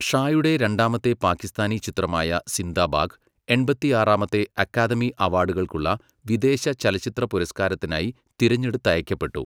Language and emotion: Malayalam, neutral